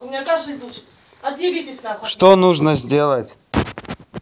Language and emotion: Russian, angry